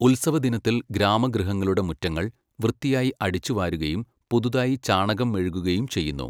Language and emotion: Malayalam, neutral